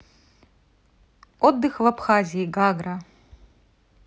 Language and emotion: Russian, neutral